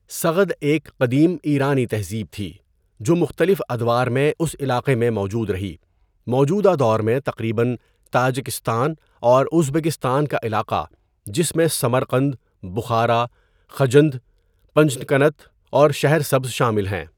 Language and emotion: Urdu, neutral